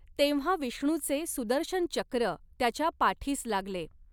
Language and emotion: Marathi, neutral